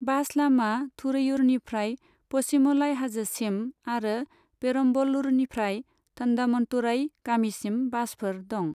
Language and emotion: Bodo, neutral